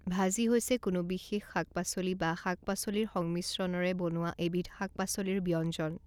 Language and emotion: Assamese, neutral